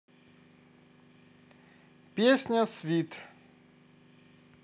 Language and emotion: Russian, positive